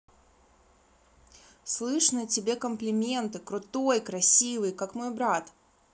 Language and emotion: Russian, positive